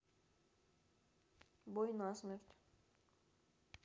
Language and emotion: Russian, neutral